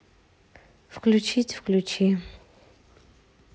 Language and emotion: Russian, sad